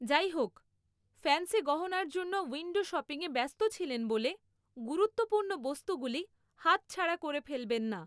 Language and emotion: Bengali, neutral